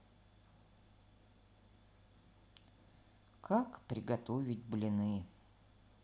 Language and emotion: Russian, sad